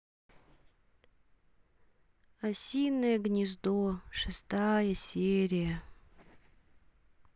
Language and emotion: Russian, sad